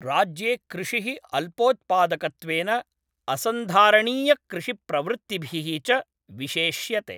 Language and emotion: Sanskrit, neutral